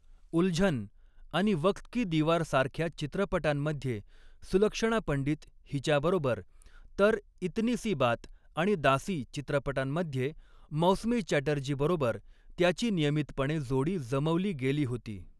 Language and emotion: Marathi, neutral